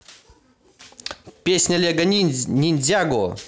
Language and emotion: Russian, positive